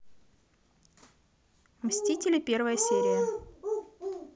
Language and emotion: Russian, neutral